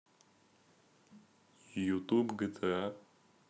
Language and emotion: Russian, neutral